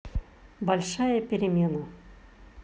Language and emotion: Russian, neutral